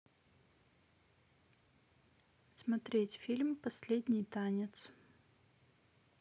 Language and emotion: Russian, neutral